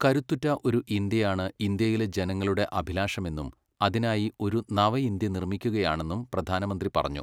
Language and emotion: Malayalam, neutral